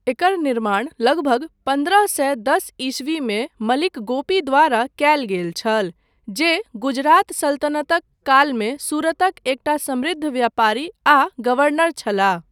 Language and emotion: Maithili, neutral